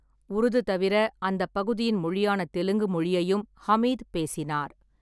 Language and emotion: Tamil, neutral